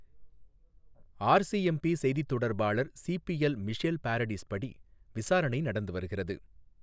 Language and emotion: Tamil, neutral